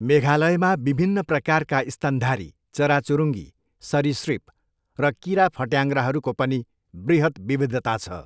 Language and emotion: Nepali, neutral